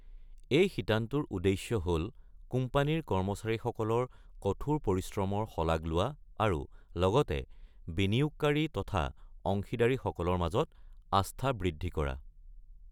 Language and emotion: Assamese, neutral